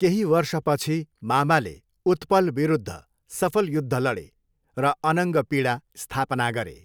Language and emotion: Nepali, neutral